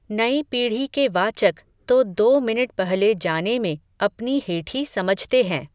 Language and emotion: Hindi, neutral